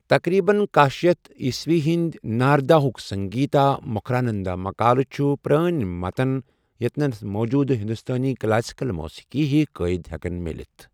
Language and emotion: Kashmiri, neutral